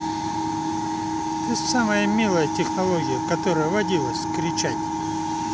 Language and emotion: Russian, positive